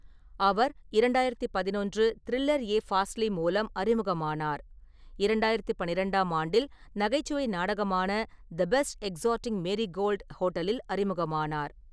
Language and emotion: Tamil, neutral